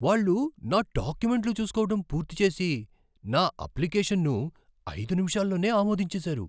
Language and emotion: Telugu, surprised